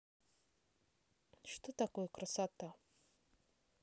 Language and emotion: Russian, neutral